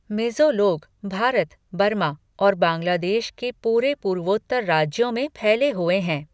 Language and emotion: Hindi, neutral